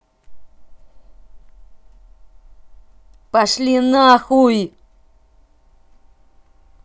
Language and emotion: Russian, angry